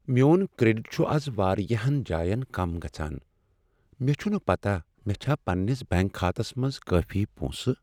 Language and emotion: Kashmiri, sad